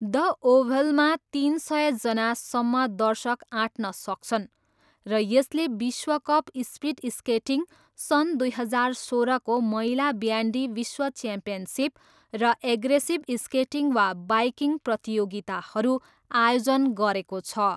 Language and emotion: Nepali, neutral